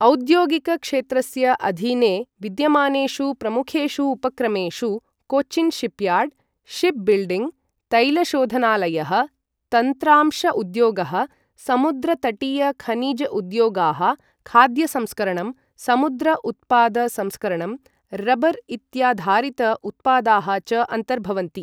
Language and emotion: Sanskrit, neutral